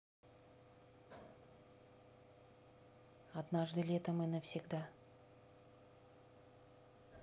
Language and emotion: Russian, neutral